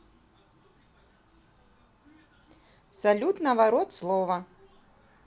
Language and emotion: Russian, neutral